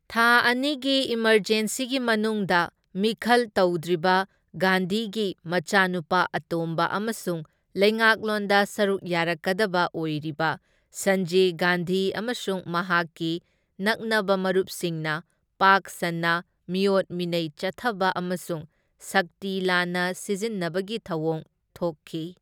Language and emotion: Manipuri, neutral